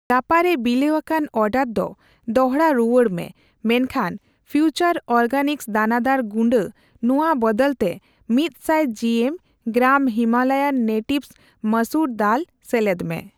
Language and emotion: Santali, neutral